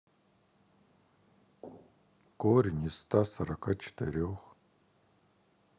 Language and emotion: Russian, sad